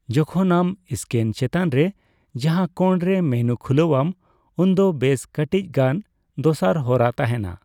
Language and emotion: Santali, neutral